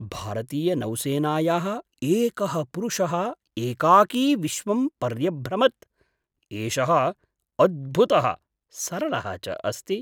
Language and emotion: Sanskrit, surprised